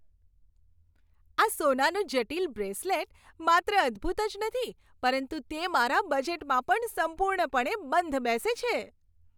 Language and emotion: Gujarati, happy